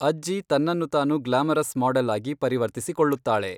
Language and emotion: Kannada, neutral